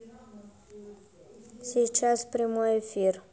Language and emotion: Russian, neutral